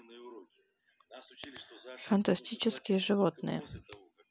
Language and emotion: Russian, neutral